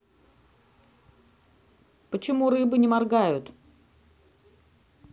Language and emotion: Russian, neutral